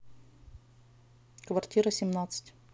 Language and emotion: Russian, neutral